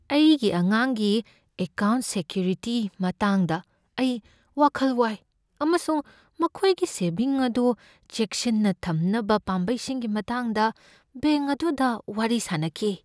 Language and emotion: Manipuri, fearful